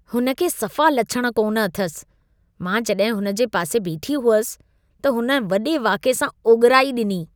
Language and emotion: Sindhi, disgusted